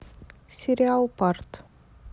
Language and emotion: Russian, neutral